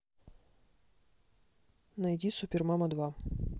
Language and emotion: Russian, neutral